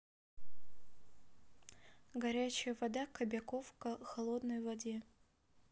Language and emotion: Russian, neutral